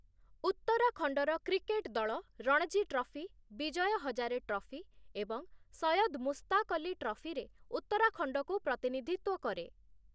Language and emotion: Odia, neutral